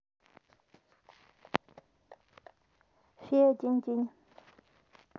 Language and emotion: Russian, neutral